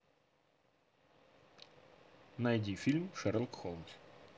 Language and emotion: Russian, neutral